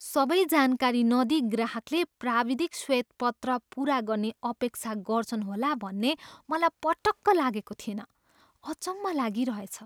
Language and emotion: Nepali, surprised